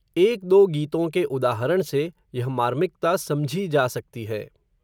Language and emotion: Hindi, neutral